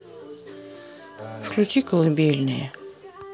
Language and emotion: Russian, neutral